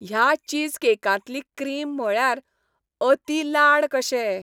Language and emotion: Goan Konkani, happy